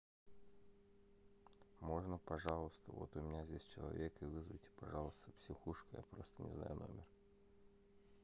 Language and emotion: Russian, sad